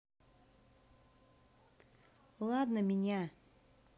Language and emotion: Russian, neutral